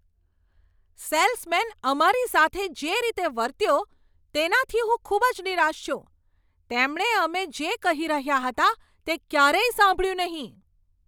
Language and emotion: Gujarati, angry